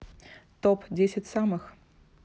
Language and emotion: Russian, neutral